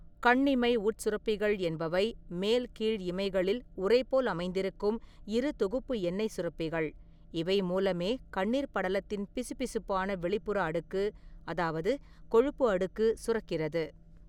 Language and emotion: Tamil, neutral